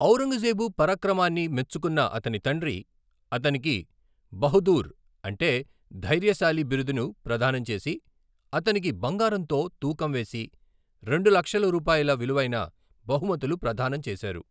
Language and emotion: Telugu, neutral